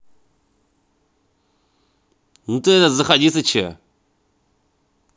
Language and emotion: Russian, positive